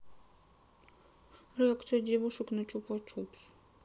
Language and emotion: Russian, sad